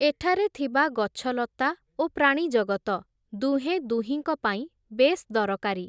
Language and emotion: Odia, neutral